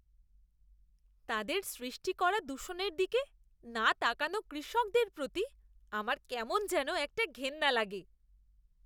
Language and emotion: Bengali, disgusted